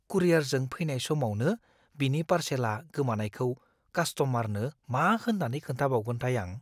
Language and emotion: Bodo, fearful